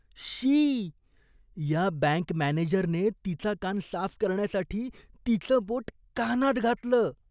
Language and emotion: Marathi, disgusted